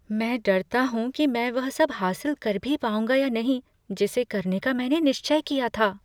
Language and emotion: Hindi, fearful